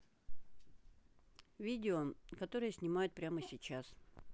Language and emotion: Russian, neutral